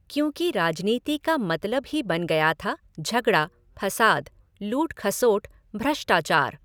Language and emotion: Hindi, neutral